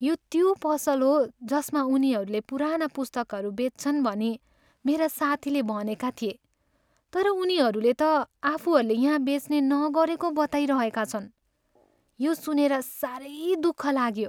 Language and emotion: Nepali, sad